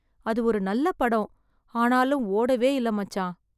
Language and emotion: Tamil, sad